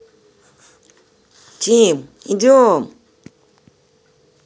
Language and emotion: Russian, neutral